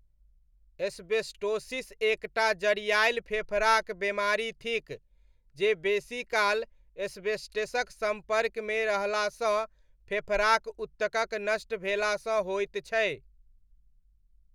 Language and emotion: Maithili, neutral